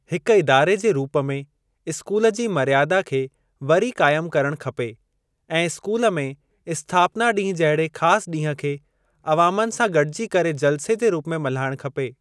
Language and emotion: Sindhi, neutral